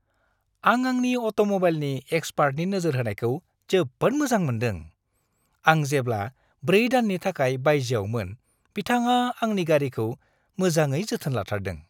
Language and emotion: Bodo, happy